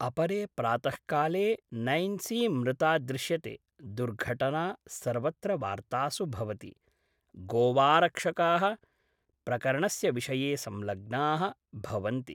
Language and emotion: Sanskrit, neutral